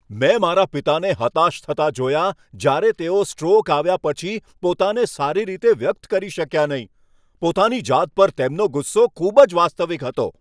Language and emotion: Gujarati, angry